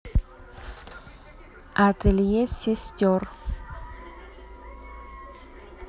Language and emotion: Russian, neutral